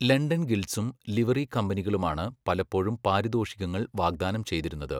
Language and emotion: Malayalam, neutral